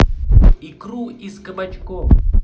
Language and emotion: Russian, positive